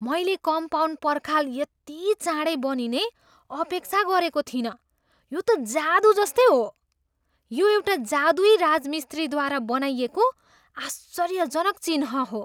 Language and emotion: Nepali, surprised